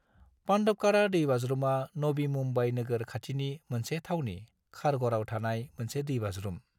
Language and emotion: Bodo, neutral